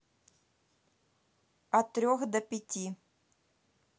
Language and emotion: Russian, neutral